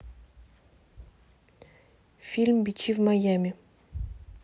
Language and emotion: Russian, neutral